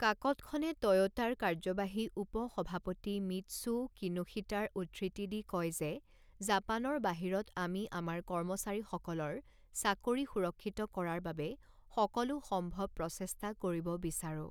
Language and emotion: Assamese, neutral